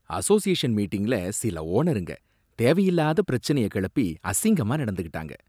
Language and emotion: Tamil, disgusted